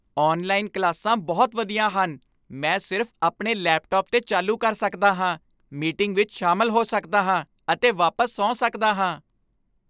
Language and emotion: Punjabi, happy